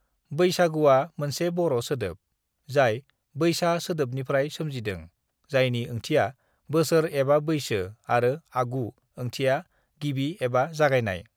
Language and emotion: Bodo, neutral